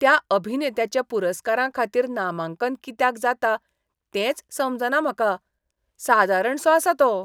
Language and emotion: Goan Konkani, disgusted